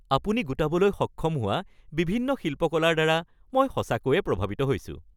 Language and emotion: Assamese, happy